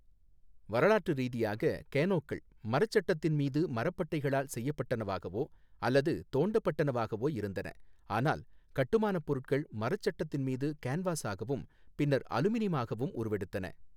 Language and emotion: Tamil, neutral